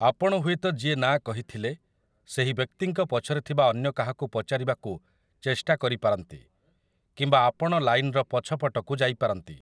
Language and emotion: Odia, neutral